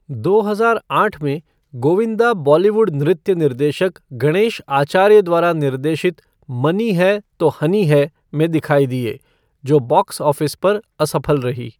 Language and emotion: Hindi, neutral